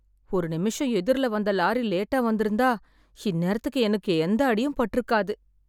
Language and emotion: Tamil, sad